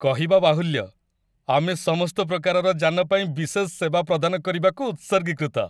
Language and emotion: Odia, happy